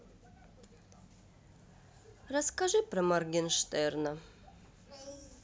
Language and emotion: Russian, neutral